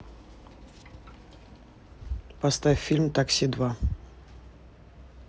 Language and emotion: Russian, neutral